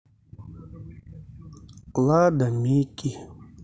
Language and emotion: Russian, sad